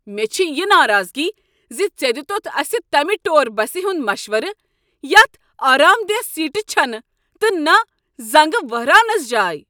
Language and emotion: Kashmiri, angry